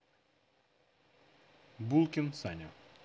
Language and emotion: Russian, neutral